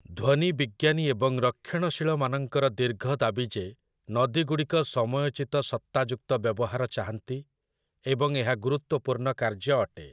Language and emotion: Odia, neutral